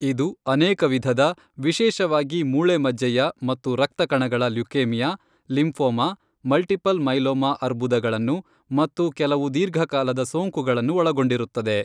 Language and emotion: Kannada, neutral